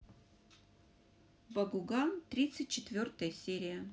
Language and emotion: Russian, positive